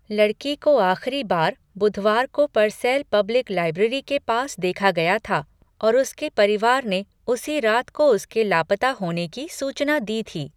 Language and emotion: Hindi, neutral